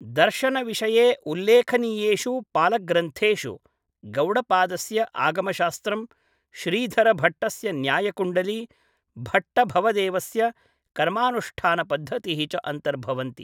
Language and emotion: Sanskrit, neutral